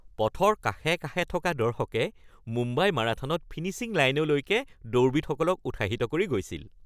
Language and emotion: Assamese, happy